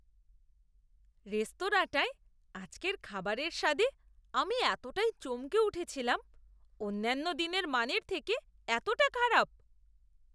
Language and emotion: Bengali, disgusted